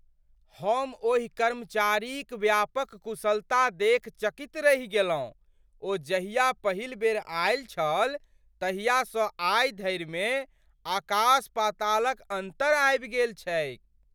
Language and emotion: Maithili, surprised